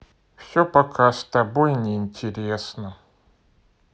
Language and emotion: Russian, sad